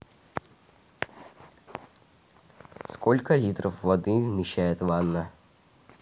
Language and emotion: Russian, neutral